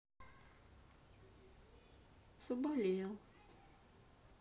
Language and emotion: Russian, sad